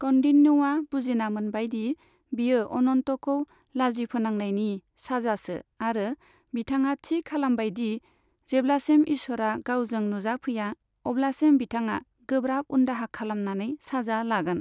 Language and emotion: Bodo, neutral